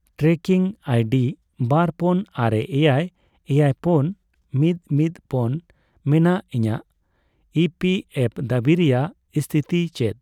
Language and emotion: Santali, neutral